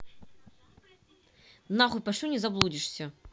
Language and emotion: Russian, angry